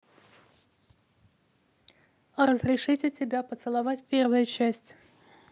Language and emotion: Russian, neutral